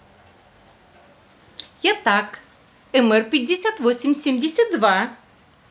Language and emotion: Russian, positive